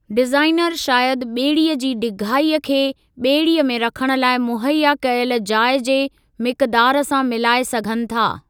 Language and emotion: Sindhi, neutral